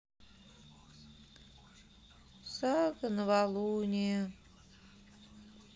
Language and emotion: Russian, sad